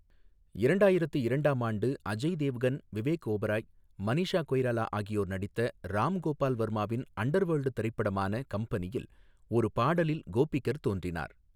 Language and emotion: Tamil, neutral